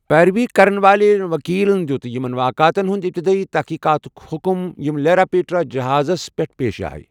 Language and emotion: Kashmiri, neutral